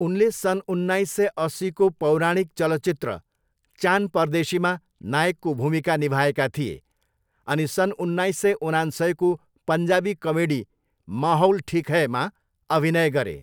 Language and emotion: Nepali, neutral